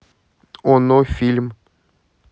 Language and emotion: Russian, neutral